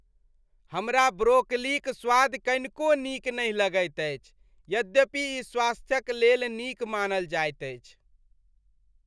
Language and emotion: Maithili, disgusted